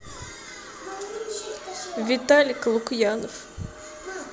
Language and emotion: Russian, sad